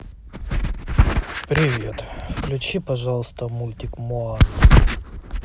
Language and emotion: Russian, neutral